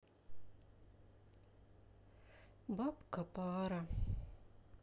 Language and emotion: Russian, sad